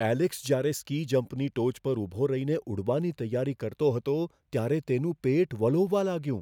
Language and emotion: Gujarati, fearful